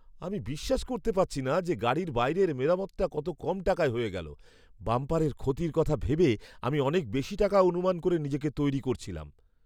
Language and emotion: Bengali, surprised